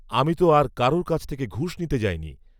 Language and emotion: Bengali, neutral